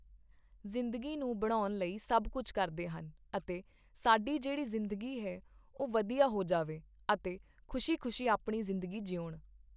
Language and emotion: Punjabi, neutral